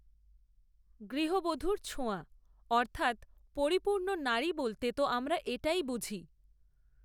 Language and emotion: Bengali, neutral